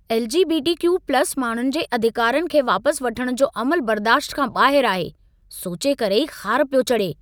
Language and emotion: Sindhi, angry